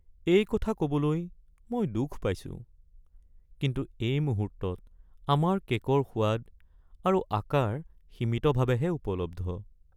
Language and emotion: Assamese, sad